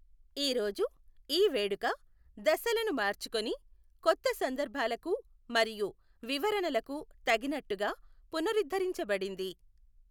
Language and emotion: Telugu, neutral